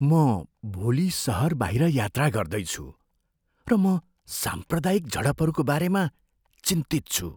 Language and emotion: Nepali, fearful